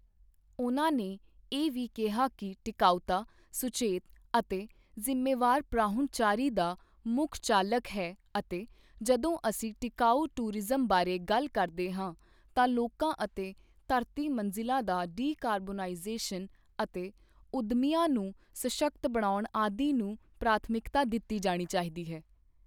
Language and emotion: Punjabi, neutral